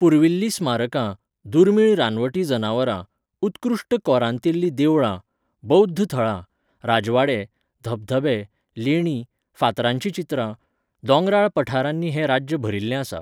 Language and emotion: Goan Konkani, neutral